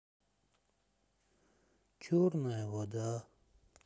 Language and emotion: Russian, sad